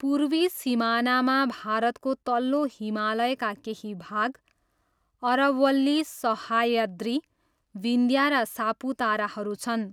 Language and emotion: Nepali, neutral